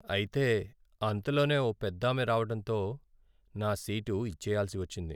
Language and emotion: Telugu, sad